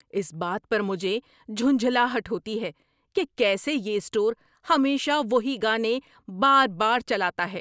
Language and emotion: Urdu, angry